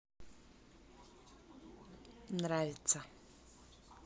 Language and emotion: Russian, neutral